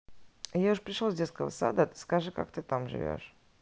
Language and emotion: Russian, neutral